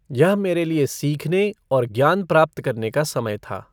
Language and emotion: Hindi, neutral